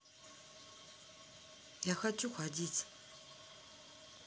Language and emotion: Russian, sad